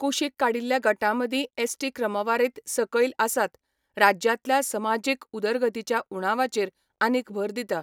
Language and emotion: Goan Konkani, neutral